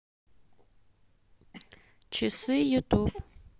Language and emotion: Russian, neutral